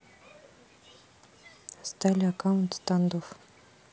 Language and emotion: Russian, neutral